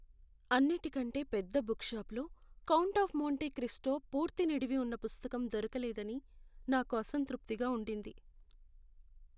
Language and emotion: Telugu, sad